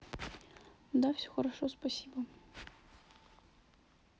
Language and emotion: Russian, sad